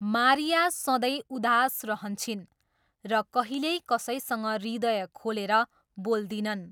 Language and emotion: Nepali, neutral